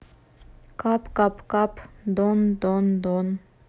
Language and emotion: Russian, neutral